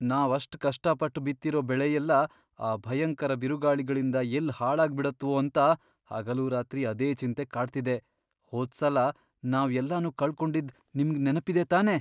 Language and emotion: Kannada, fearful